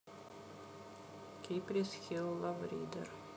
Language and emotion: Russian, neutral